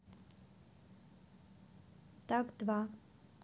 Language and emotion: Russian, neutral